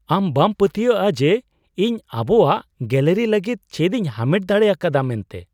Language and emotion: Santali, surprised